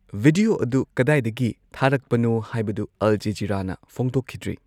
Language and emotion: Manipuri, neutral